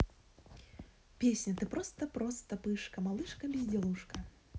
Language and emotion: Russian, positive